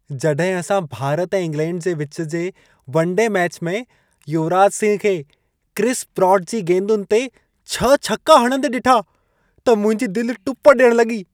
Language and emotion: Sindhi, happy